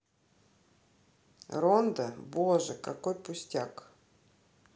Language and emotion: Russian, neutral